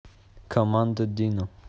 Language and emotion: Russian, neutral